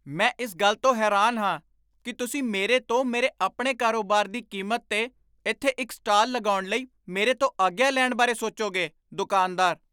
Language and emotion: Punjabi, surprised